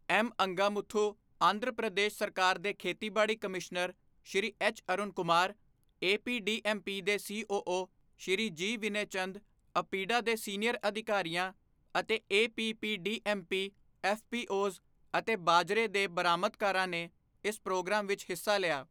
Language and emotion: Punjabi, neutral